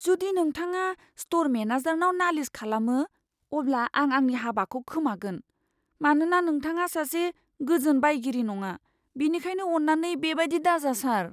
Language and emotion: Bodo, fearful